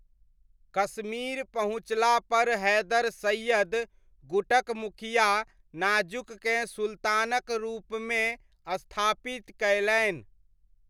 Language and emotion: Maithili, neutral